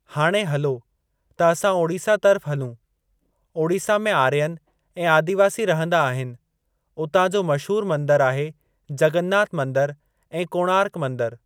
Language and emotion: Sindhi, neutral